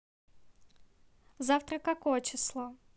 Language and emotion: Russian, neutral